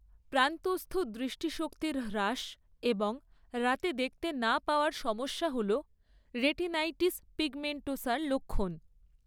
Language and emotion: Bengali, neutral